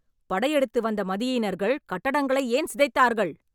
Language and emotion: Tamil, angry